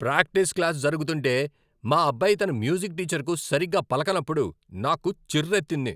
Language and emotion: Telugu, angry